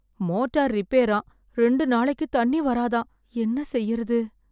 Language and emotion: Tamil, fearful